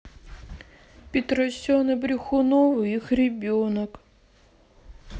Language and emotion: Russian, sad